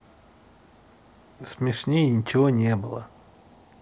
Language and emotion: Russian, neutral